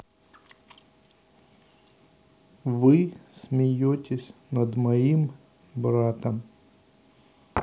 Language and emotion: Russian, neutral